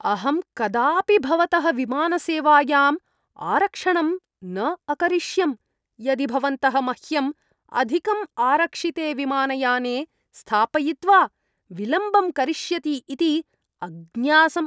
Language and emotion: Sanskrit, disgusted